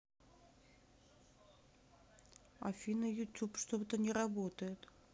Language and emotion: Russian, neutral